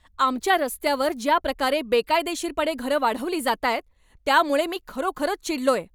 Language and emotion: Marathi, angry